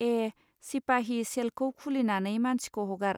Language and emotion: Bodo, neutral